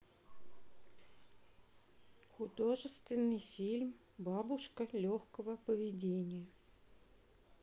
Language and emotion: Russian, neutral